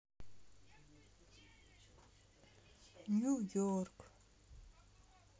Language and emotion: Russian, sad